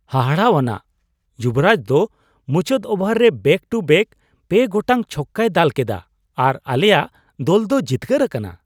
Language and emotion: Santali, surprised